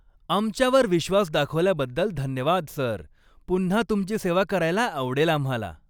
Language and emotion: Marathi, happy